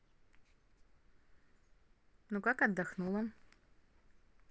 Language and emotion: Russian, neutral